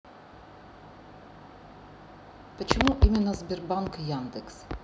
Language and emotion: Russian, neutral